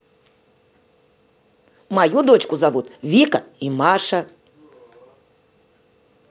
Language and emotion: Russian, positive